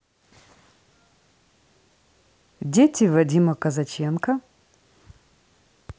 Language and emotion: Russian, neutral